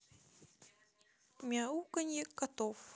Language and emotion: Russian, neutral